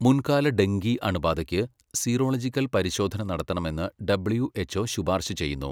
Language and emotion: Malayalam, neutral